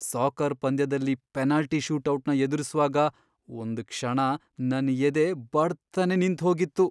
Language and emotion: Kannada, fearful